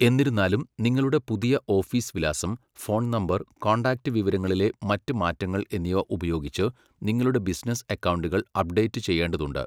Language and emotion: Malayalam, neutral